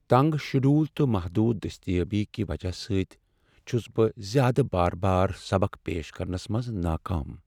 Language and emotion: Kashmiri, sad